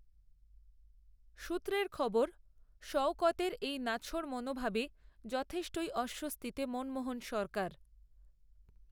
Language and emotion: Bengali, neutral